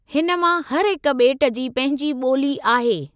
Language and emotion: Sindhi, neutral